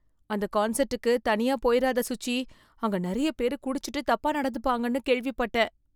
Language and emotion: Tamil, fearful